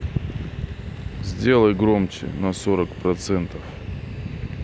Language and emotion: Russian, neutral